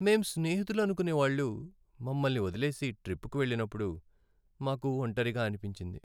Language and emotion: Telugu, sad